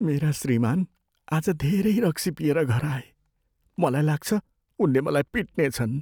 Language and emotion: Nepali, fearful